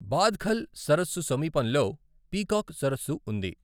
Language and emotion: Telugu, neutral